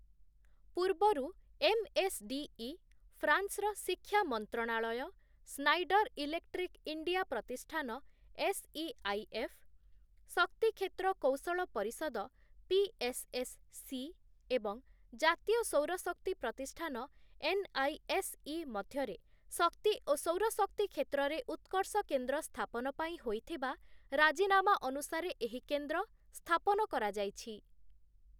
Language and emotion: Odia, neutral